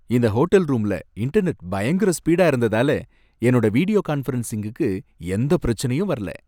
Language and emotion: Tamil, happy